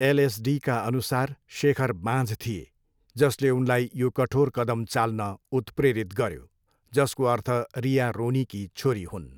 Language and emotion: Nepali, neutral